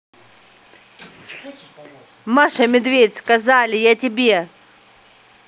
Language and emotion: Russian, angry